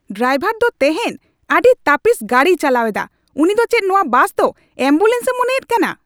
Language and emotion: Santali, angry